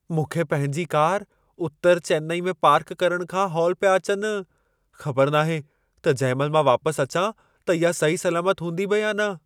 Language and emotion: Sindhi, fearful